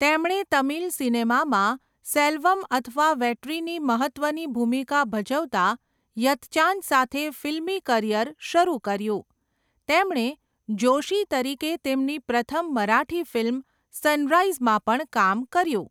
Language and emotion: Gujarati, neutral